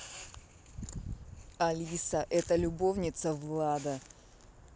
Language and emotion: Russian, neutral